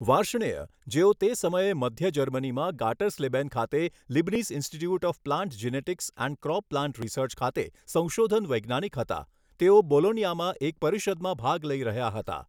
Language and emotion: Gujarati, neutral